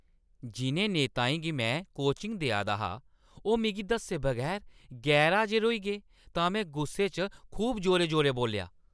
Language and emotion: Dogri, angry